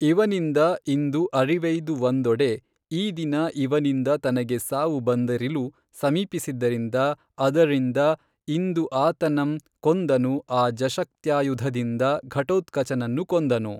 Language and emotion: Kannada, neutral